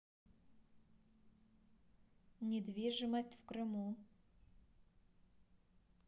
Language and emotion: Russian, neutral